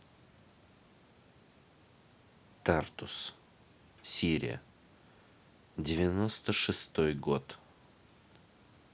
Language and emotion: Russian, neutral